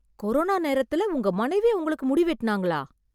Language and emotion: Tamil, surprised